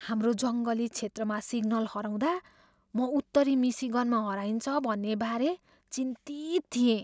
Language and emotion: Nepali, fearful